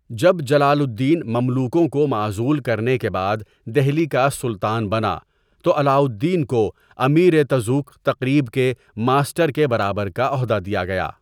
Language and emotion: Urdu, neutral